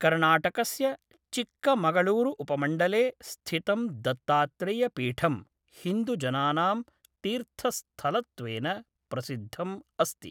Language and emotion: Sanskrit, neutral